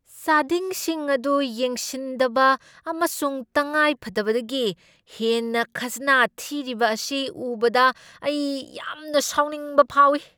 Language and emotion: Manipuri, angry